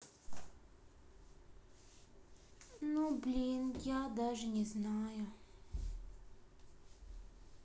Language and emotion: Russian, sad